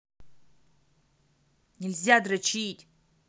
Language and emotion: Russian, angry